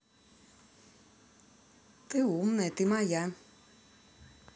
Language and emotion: Russian, positive